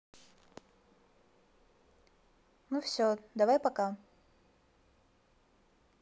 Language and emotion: Russian, neutral